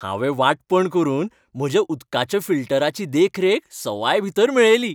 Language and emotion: Goan Konkani, happy